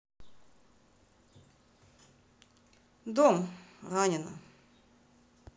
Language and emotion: Russian, neutral